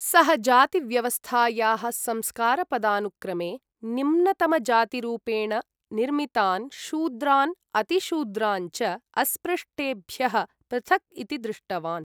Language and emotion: Sanskrit, neutral